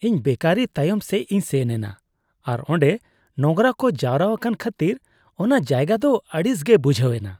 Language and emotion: Santali, disgusted